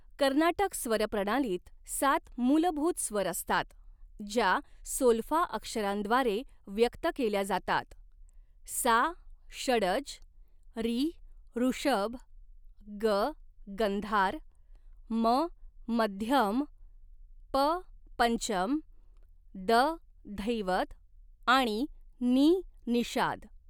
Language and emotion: Marathi, neutral